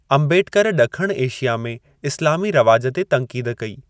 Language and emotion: Sindhi, neutral